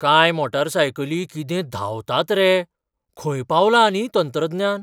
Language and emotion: Goan Konkani, surprised